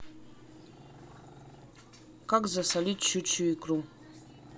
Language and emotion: Russian, neutral